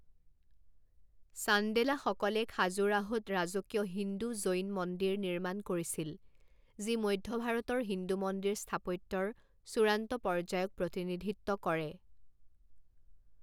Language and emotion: Assamese, neutral